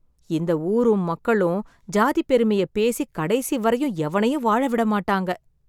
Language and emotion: Tamil, sad